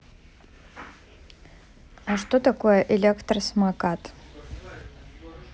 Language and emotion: Russian, neutral